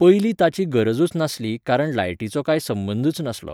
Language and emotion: Goan Konkani, neutral